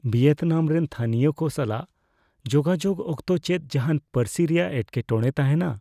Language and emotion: Santali, fearful